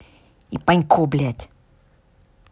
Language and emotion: Russian, angry